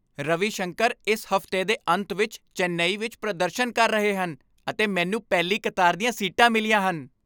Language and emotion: Punjabi, happy